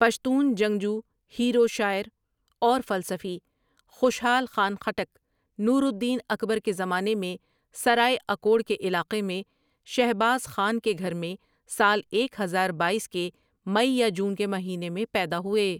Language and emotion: Urdu, neutral